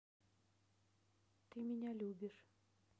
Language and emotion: Russian, neutral